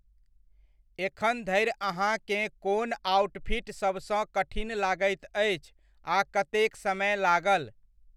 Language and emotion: Maithili, neutral